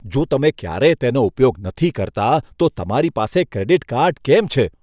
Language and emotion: Gujarati, disgusted